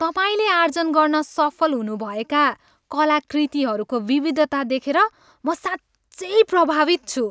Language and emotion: Nepali, happy